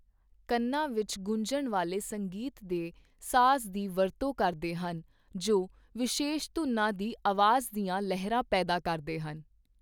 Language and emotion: Punjabi, neutral